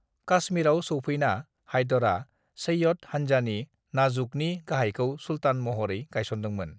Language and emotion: Bodo, neutral